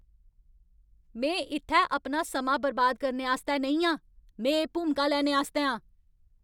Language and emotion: Dogri, angry